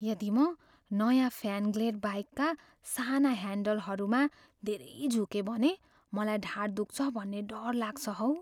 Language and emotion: Nepali, fearful